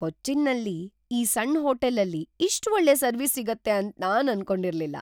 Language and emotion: Kannada, surprised